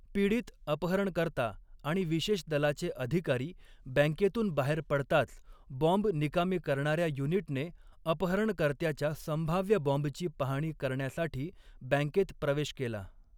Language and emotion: Marathi, neutral